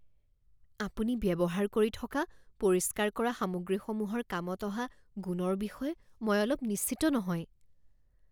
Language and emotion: Assamese, fearful